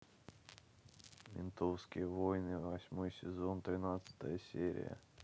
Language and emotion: Russian, sad